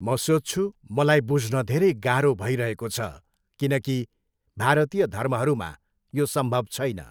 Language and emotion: Nepali, neutral